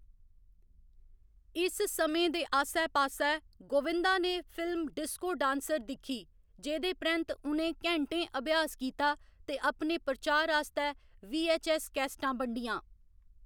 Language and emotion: Dogri, neutral